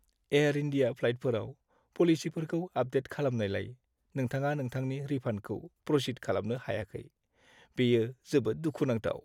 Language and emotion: Bodo, sad